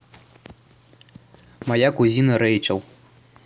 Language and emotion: Russian, neutral